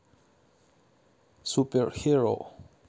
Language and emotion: Russian, neutral